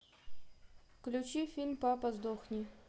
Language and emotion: Russian, neutral